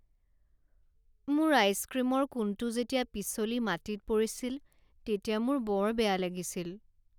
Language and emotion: Assamese, sad